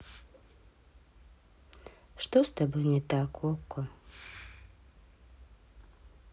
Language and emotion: Russian, sad